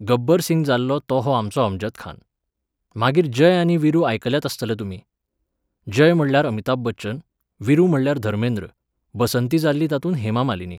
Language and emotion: Goan Konkani, neutral